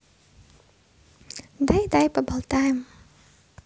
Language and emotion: Russian, positive